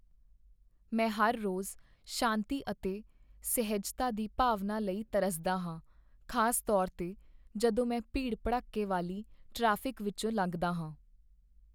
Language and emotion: Punjabi, sad